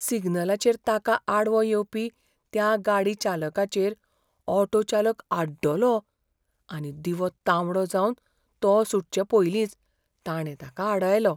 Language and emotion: Goan Konkani, fearful